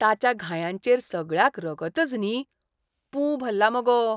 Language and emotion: Goan Konkani, disgusted